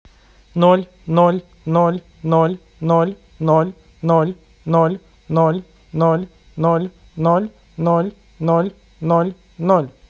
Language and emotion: Russian, neutral